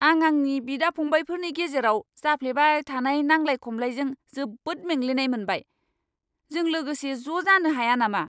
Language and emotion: Bodo, angry